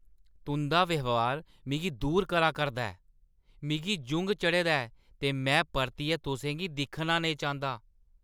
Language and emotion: Dogri, angry